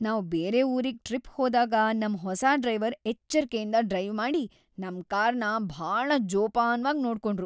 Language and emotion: Kannada, happy